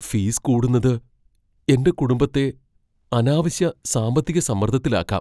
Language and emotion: Malayalam, fearful